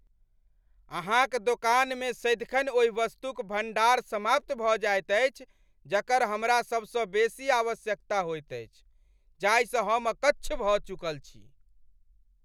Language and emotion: Maithili, angry